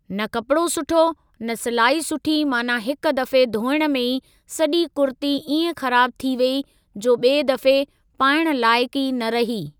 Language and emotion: Sindhi, neutral